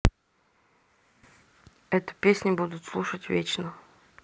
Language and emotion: Russian, neutral